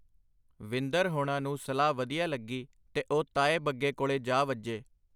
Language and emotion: Punjabi, neutral